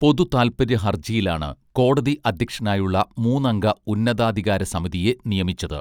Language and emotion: Malayalam, neutral